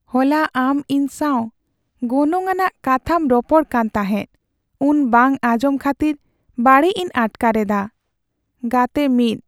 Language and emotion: Santali, sad